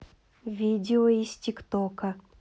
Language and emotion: Russian, neutral